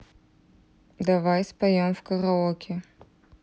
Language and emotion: Russian, neutral